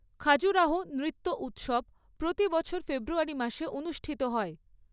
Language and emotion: Bengali, neutral